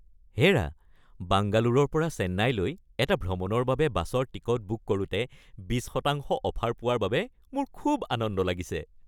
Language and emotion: Assamese, happy